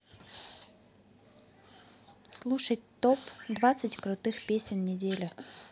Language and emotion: Russian, neutral